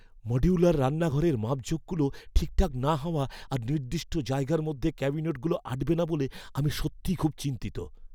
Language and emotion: Bengali, fearful